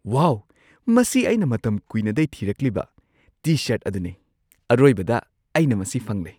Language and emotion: Manipuri, surprised